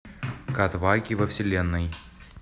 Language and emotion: Russian, neutral